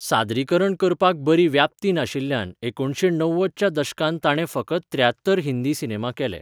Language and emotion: Goan Konkani, neutral